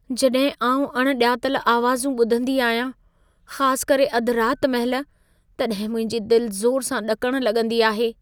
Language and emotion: Sindhi, fearful